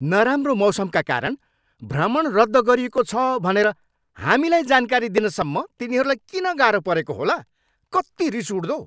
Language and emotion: Nepali, angry